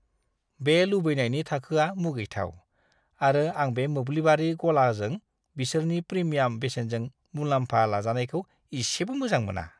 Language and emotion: Bodo, disgusted